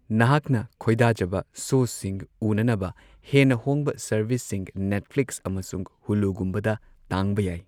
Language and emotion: Manipuri, neutral